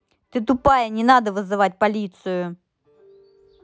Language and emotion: Russian, angry